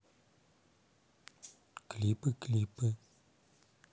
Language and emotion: Russian, neutral